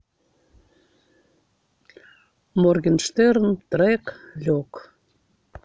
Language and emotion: Russian, neutral